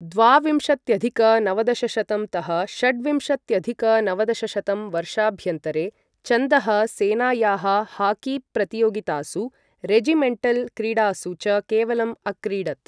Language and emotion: Sanskrit, neutral